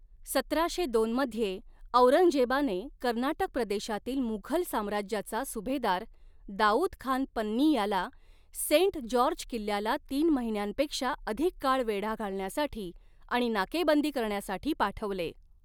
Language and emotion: Marathi, neutral